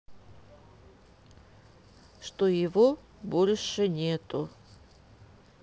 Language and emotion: Russian, neutral